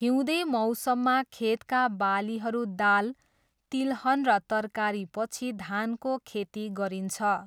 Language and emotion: Nepali, neutral